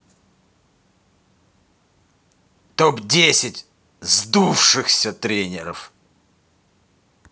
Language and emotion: Russian, angry